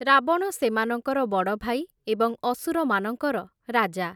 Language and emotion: Odia, neutral